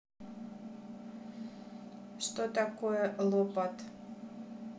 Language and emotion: Russian, neutral